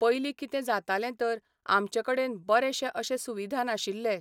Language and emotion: Goan Konkani, neutral